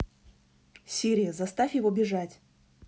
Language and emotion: Russian, neutral